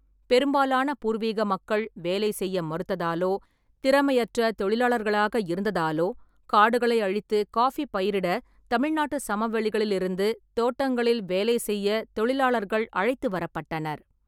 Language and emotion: Tamil, neutral